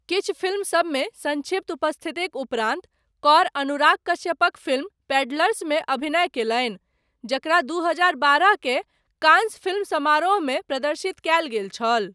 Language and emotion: Maithili, neutral